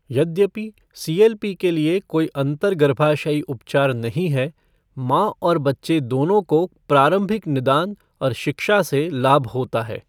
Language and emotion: Hindi, neutral